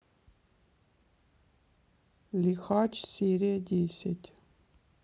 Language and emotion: Russian, neutral